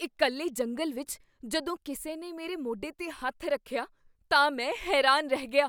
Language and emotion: Punjabi, surprised